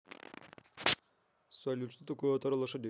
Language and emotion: Russian, neutral